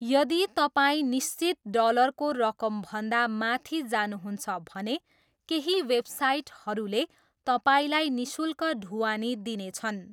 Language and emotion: Nepali, neutral